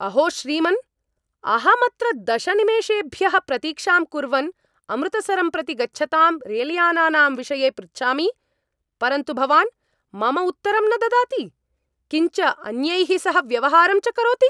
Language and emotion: Sanskrit, angry